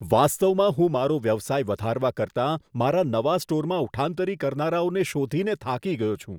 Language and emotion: Gujarati, disgusted